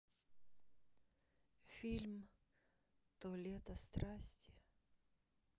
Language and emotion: Russian, sad